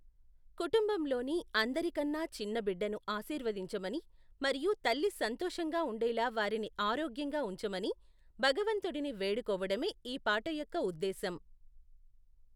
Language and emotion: Telugu, neutral